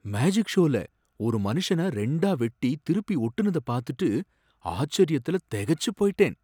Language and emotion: Tamil, surprised